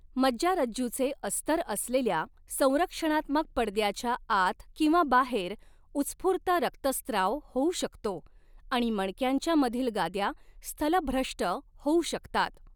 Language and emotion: Marathi, neutral